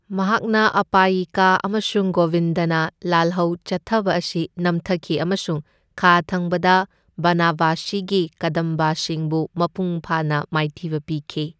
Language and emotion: Manipuri, neutral